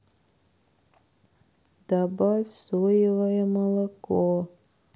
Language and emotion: Russian, sad